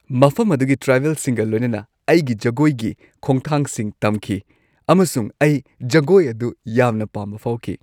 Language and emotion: Manipuri, happy